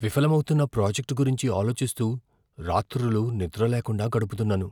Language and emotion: Telugu, fearful